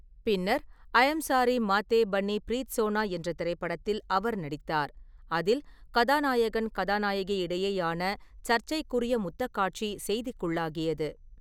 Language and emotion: Tamil, neutral